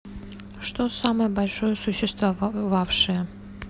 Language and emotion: Russian, neutral